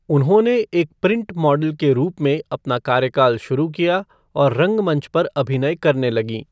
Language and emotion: Hindi, neutral